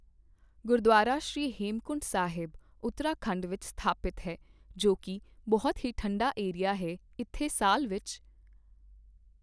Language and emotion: Punjabi, neutral